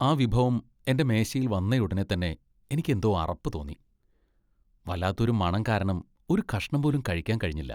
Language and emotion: Malayalam, disgusted